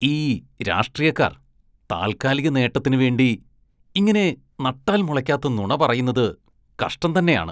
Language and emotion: Malayalam, disgusted